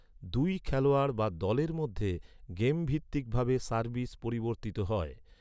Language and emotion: Bengali, neutral